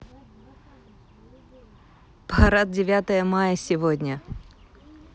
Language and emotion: Russian, neutral